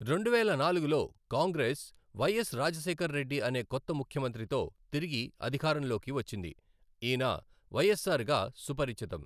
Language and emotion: Telugu, neutral